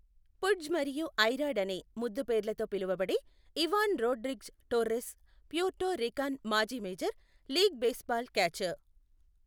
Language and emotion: Telugu, neutral